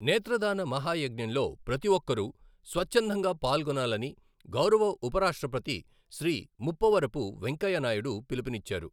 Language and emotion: Telugu, neutral